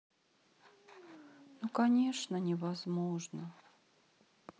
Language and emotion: Russian, sad